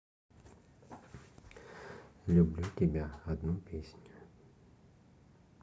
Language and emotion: Russian, neutral